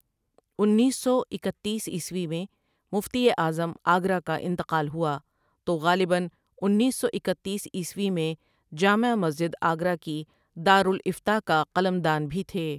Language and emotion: Urdu, neutral